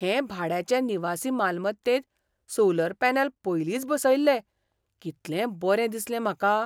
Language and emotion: Goan Konkani, surprised